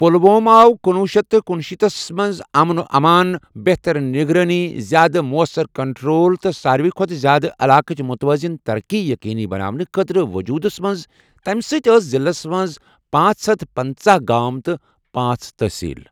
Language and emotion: Kashmiri, neutral